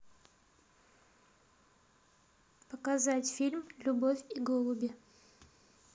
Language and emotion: Russian, neutral